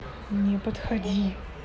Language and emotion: Russian, angry